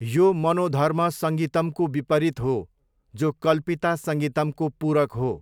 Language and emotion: Nepali, neutral